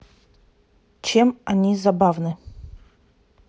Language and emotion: Russian, neutral